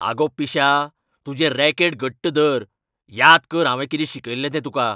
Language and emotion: Goan Konkani, angry